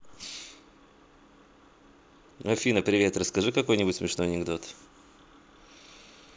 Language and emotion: Russian, positive